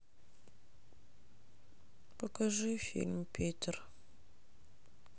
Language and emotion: Russian, sad